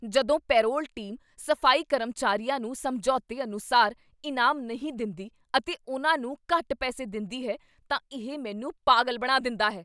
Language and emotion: Punjabi, angry